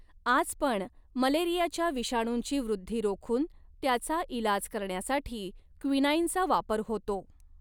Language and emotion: Marathi, neutral